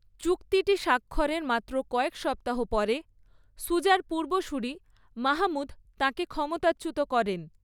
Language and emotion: Bengali, neutral